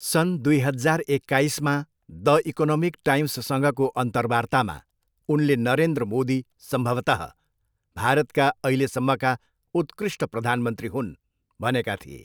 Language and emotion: Nepali, neutral